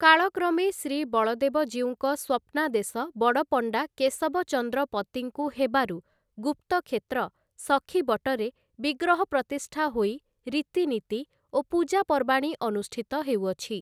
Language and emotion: Odia, neutral